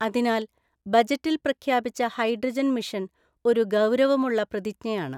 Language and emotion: Malayalam, neutral